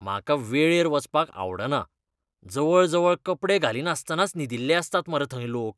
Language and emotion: Goan Konkani, disgusted